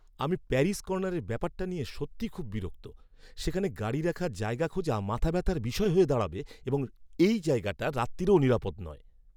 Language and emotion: Bengali, angry